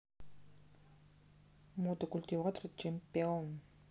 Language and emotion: Russian, neutral